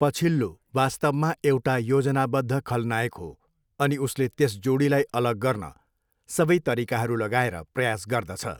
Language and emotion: Nepali, neutral